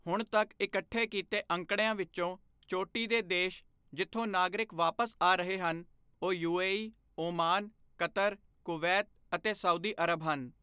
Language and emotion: Punjabi, neutral